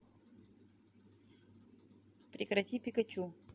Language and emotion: Russian, neutral